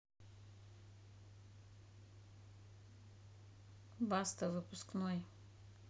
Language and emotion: Russian, neutral